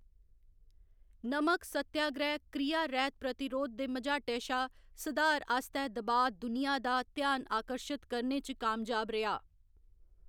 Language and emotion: Dogri, neutral